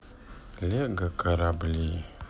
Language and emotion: Russian, sad